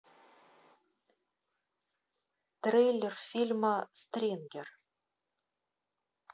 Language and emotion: Russian, neutral